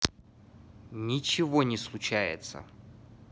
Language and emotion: Russian, neutral